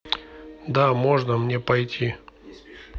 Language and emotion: Russian, neutral